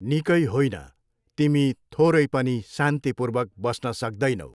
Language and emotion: Nepali, neutral